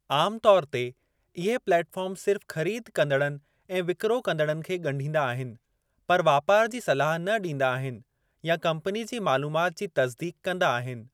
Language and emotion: Sindhi, neutral